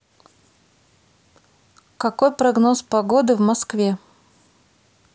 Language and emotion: Russian, neutral